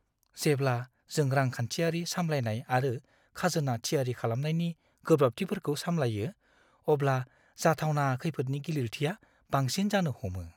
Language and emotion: Bodo, fearful